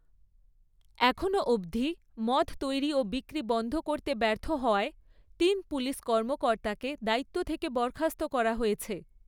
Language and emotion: Bengali, neutral